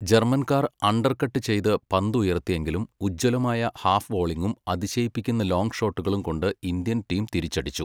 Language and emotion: Malayalam, neutral